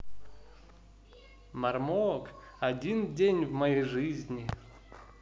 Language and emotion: Russian, positive